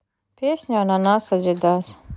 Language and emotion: Russian, neutral